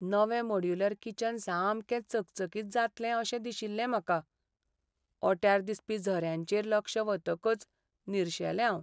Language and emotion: Goan Konkani, sad